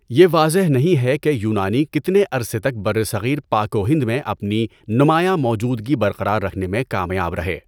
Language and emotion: Urdu, neutral